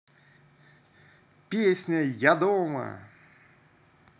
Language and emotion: Russian, positive